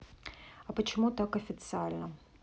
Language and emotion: Russian, neutral